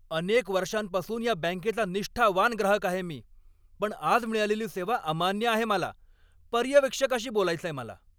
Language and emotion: Marathi, angry